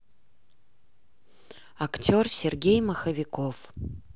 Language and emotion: Russian, neutral